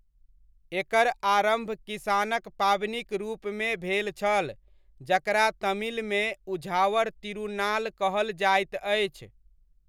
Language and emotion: Maithili, neutral